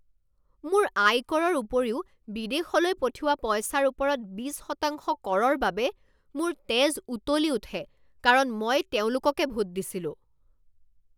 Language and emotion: Assamese, angry